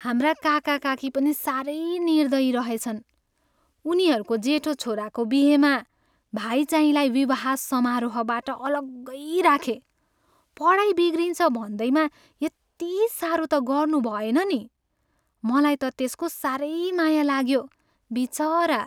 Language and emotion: Nepali, sad